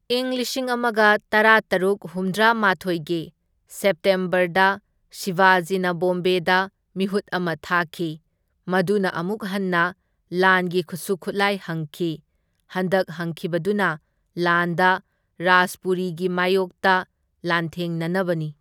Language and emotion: Manipuri, neutral